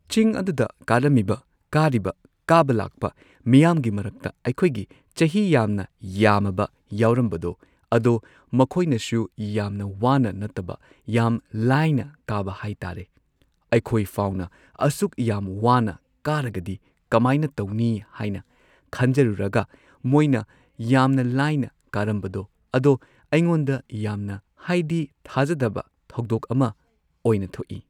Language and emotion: Manipuri, neutral